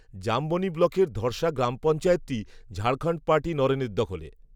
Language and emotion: Bengali, neutral